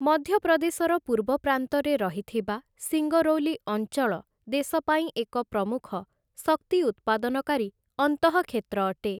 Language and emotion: Odia, neutral